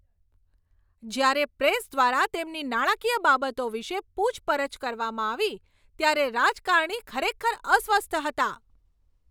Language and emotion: Gujarati, angry